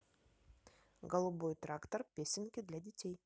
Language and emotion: Russian, neutral